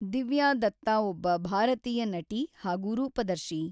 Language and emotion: Kannada, neutral